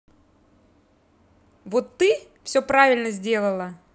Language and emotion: Russian, neutral